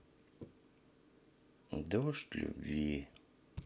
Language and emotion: Russian, sad